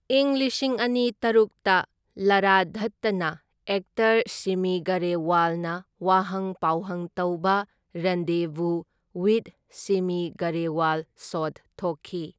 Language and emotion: Manipuri, neutral